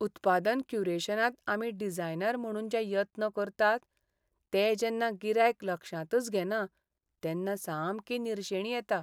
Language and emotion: Goan Konkani, sad